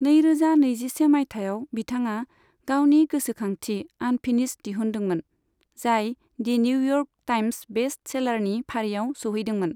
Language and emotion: Bodo, neutral